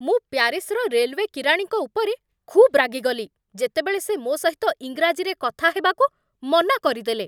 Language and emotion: Odia, angry